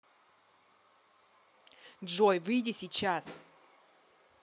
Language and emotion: Russian, angry